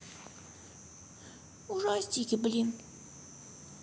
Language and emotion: Russian, sad